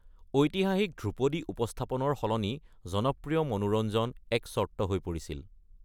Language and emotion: Assamese, neutral